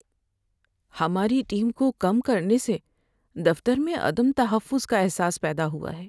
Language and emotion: Urdu, sad